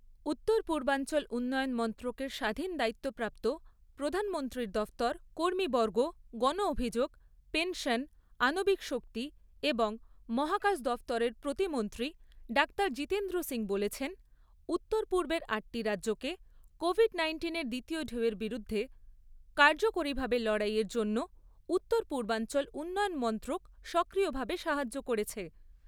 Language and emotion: Bengali, neutral